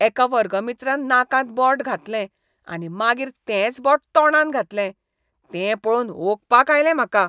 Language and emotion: Goan Konkani, disgusted